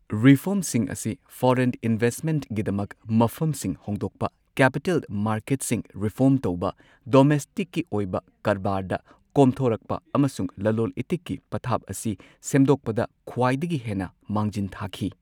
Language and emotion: Manipuri, neutral